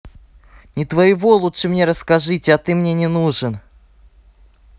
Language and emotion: Russian, angry